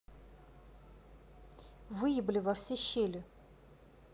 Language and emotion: Russian, angry